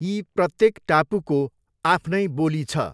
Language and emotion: Nepali, neutral